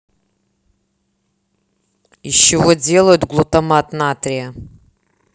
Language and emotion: Russian, neutral